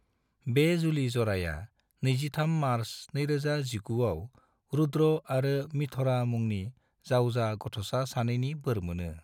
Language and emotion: Bodo, neutral